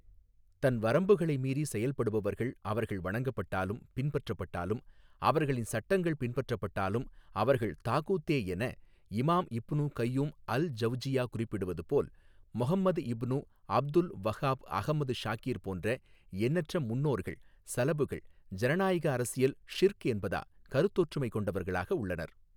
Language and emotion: Tamil, neutral